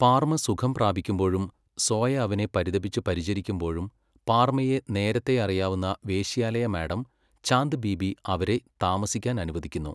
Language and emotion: Malayalam, neutral